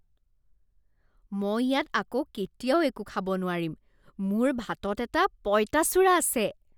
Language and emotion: Assamese, disgusted